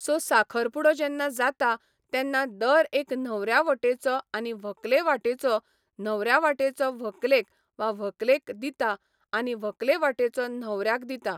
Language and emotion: Goan Konkani, neutral